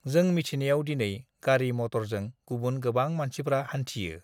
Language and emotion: Bodo, neutral